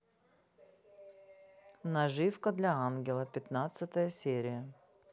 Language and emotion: Russian, neutral